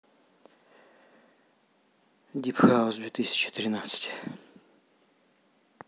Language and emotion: Russian, sad